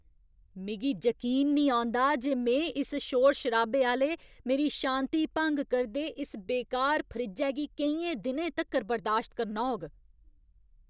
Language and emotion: Dogri, angry